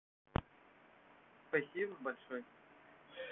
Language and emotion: Russian, positive